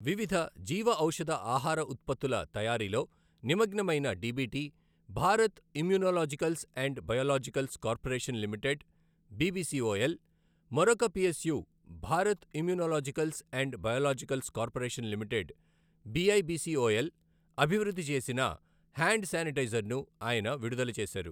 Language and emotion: Telugu, neutral